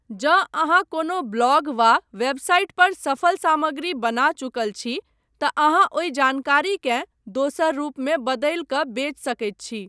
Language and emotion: Maithili, neutral